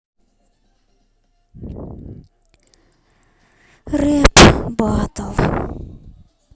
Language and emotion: Russian, sad